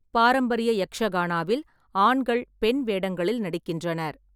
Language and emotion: Tamil, neutral